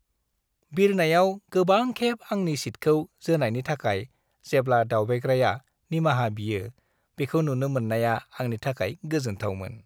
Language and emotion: Bodo, happy